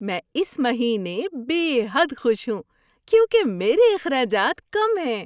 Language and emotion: Urdu, happy